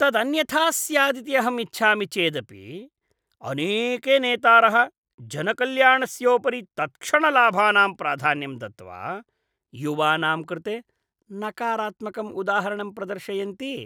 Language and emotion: Sanskrit, disgusted